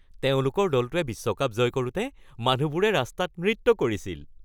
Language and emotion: Assamese, happy